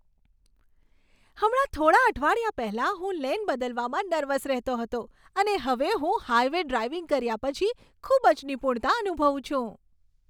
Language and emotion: Gujarati, happy